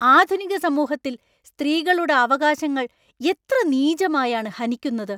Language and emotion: Malayalam, angry